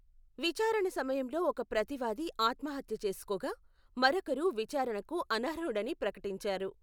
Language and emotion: Telugu, neutral